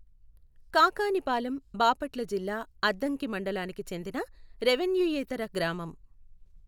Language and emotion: Telugu, neutral